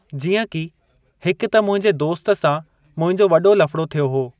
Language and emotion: Sindhi, neutral